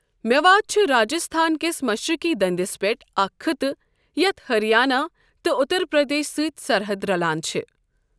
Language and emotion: Kashmiri, neutral